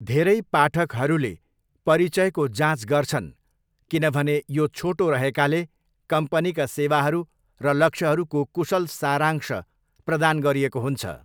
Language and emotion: Nepali, neutral